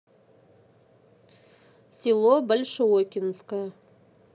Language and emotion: Russian, neutral